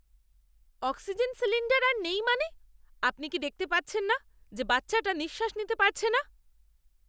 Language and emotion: Bengali, angry